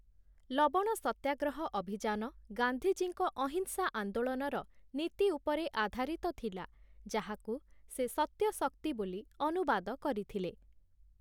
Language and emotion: Odia, neutral